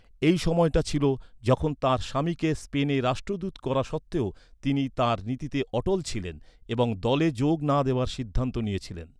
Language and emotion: Bengali, neutral